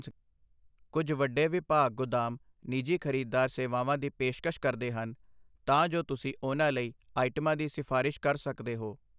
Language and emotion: Punjabi, neutral